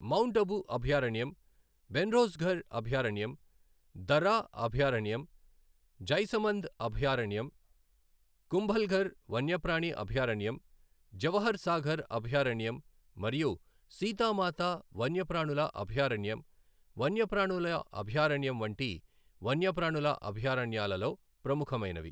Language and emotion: Telugu, neutral